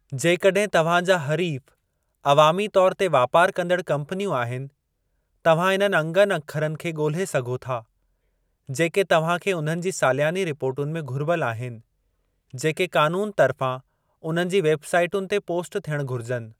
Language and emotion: Sindhi, neutral